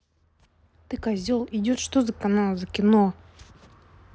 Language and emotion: Russian, angry